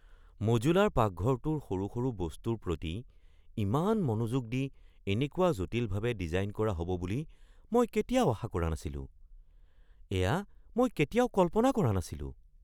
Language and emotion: Assamese, surprised